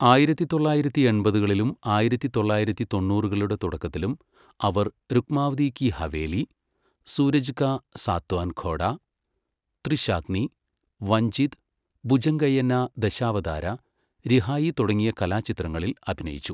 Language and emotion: Malayalam, neutral